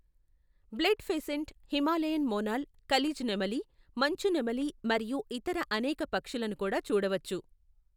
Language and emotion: Telugu, neutral